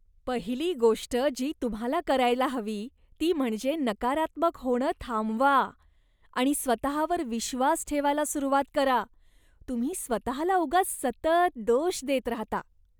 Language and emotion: Marathi, disgusted